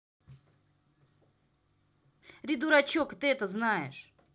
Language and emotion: Russian, angry